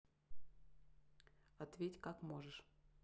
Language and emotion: Russian, neutral